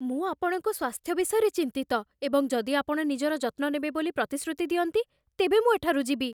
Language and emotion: Odia, fearful